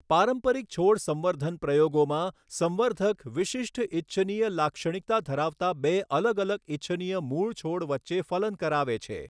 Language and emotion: Gujarati, neutral